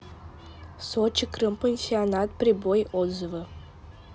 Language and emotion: Russian, neutral